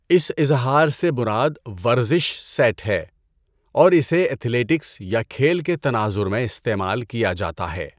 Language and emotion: Urdu, neutral